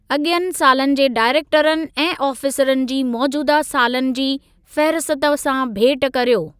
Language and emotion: Sindhi, neutral